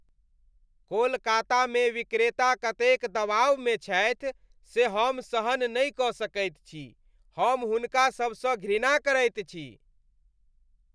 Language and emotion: Maithili, disgusted